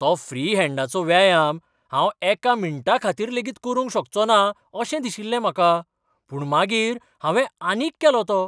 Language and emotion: Goan Konkani, surprised